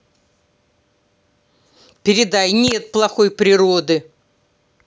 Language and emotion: Russian, angry